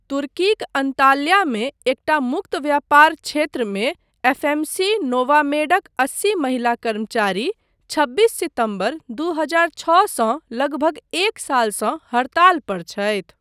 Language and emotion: Maithili, neutral